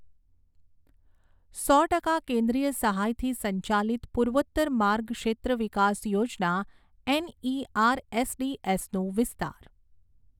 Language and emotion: Gujarati, neutral